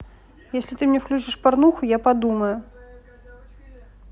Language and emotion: Russian, neutral